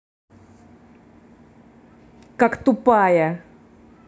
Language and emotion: Russian, angry